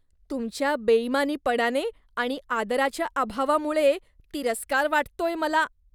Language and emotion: Marathi, disgusted